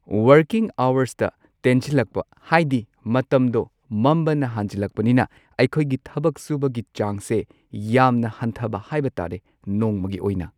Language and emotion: Manipuri, neutral